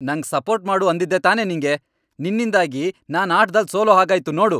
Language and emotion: Kannada, angry